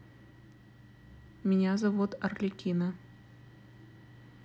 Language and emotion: Russian, neutral